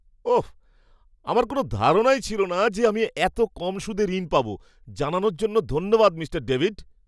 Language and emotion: Bengali, surprised